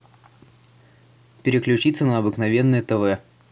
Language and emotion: Russian, neutral